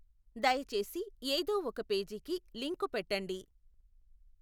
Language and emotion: Telugu, neutral